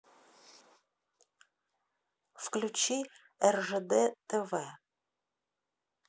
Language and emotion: Russian, neutral